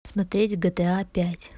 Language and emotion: Russian, neutral